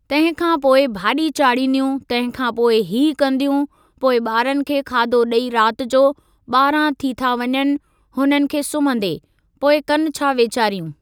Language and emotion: Sindhi, neutral